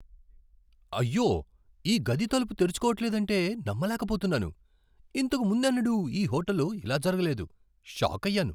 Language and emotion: Telugu, surprised